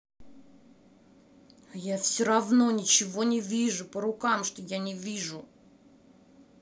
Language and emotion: Russian, angry